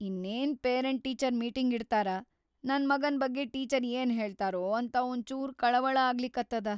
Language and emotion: Kannada, fearful